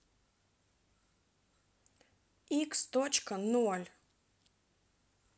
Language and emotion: Russian, neutral